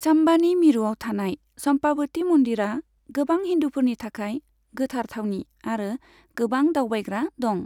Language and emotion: Bodo, neutral